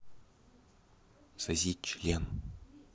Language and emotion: Russian, neutral